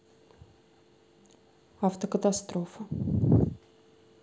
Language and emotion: Russian, neutral